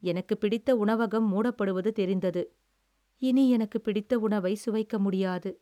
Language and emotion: Tamil, sad